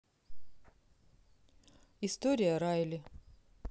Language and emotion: Russian, neutral